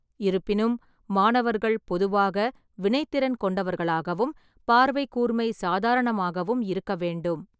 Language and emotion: Tamil, neutral